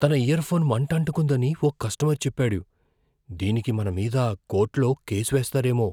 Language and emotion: Telugu, fearful